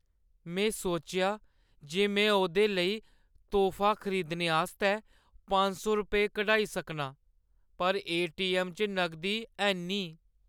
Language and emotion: Dogri, sad